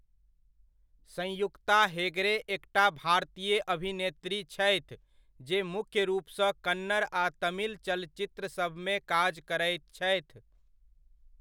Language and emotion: Maithili, neutral